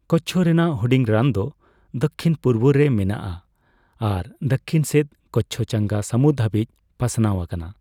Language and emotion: Santali, neutral